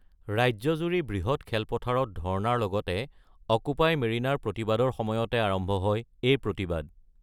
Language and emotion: Assamese, neutral